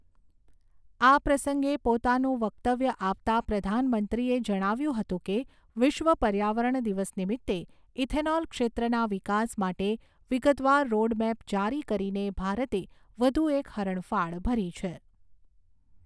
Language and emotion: Gujarati, neutral